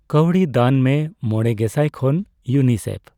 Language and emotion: Santali, neutral